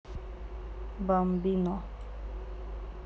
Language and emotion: Russian, neutral